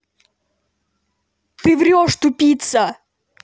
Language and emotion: Russian, angry